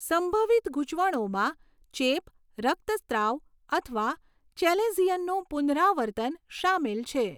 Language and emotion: Gujarati, neutral